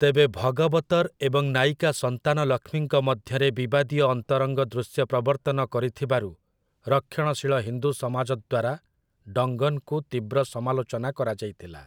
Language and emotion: Odia, neutral